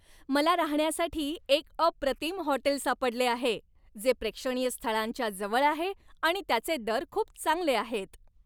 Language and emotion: Marathi, happy